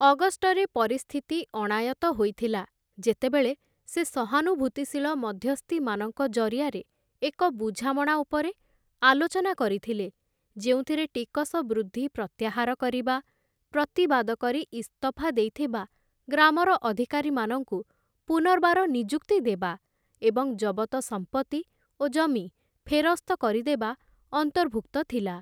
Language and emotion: Odia, neutral